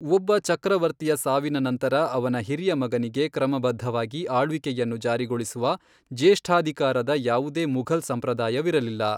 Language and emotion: Kannada, neutral